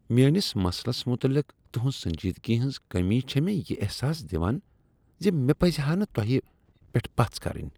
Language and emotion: Kashmiri, disgusted